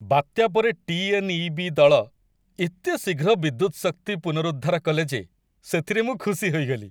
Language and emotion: Odia, happy